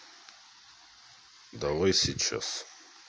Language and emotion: Russian, neutral